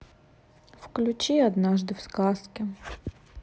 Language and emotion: Russian, sad